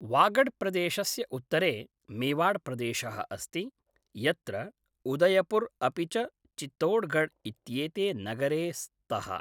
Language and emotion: Sanskrit, neutral